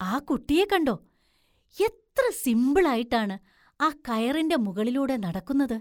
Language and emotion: Malayalam, surprised